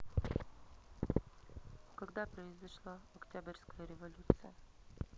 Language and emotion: Russian, neutral